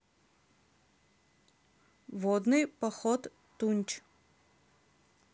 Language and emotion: Russian, neutral